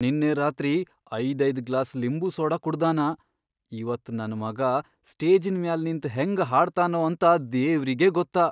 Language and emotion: Kannada, fearful